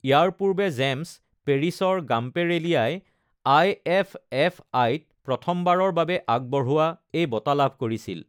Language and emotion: Assamese, neutral